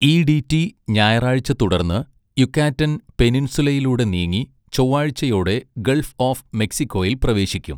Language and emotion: Malayalam, neutral